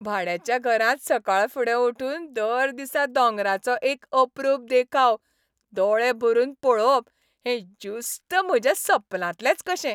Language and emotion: Goan Konkani, happy